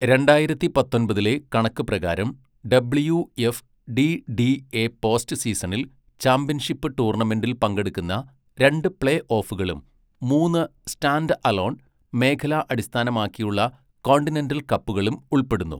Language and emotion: Malayalam, neutral